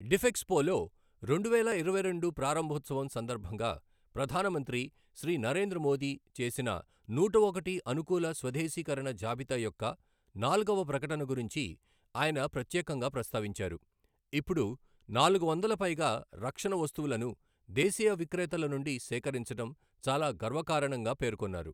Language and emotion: Telugu, neutral